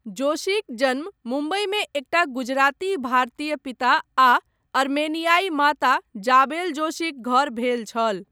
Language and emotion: Maithili, neutral